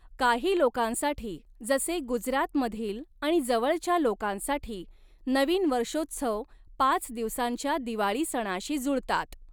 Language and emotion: Marathi, neutral